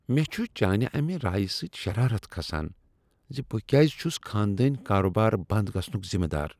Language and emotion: Kashmiri, disgusted